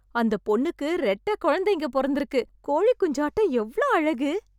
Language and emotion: Tamil, happy